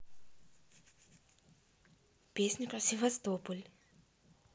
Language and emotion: Russian, neutral